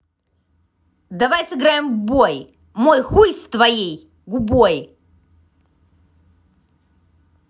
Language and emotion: Russian, angry